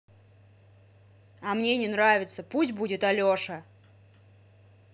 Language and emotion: Russian, angry